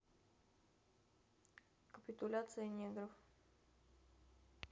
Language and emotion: Russian, neutral